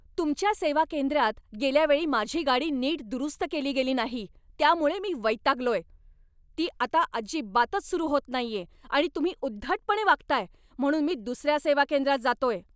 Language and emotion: Marathi, angry